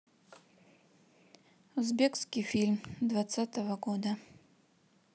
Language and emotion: Russian, neutral